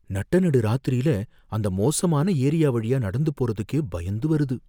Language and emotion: Tamil, fearful